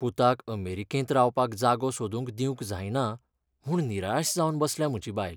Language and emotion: Goan Konkani, sad